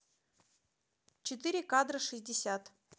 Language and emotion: Russian, neutral